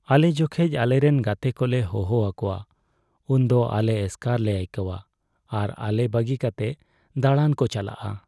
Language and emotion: Santali, sad